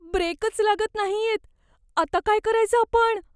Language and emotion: Marathi, fearful